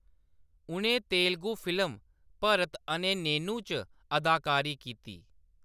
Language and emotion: Dogri, neutral